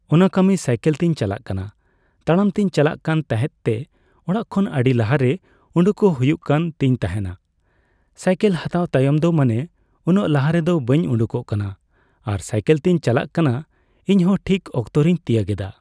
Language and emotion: Santali, neutral